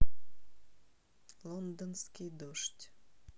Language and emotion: Russian, neutral